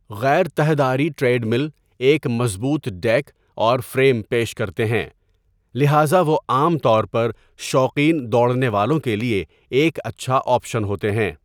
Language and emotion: Urdu, neutral